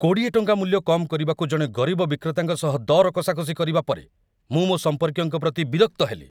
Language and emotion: Odia, angry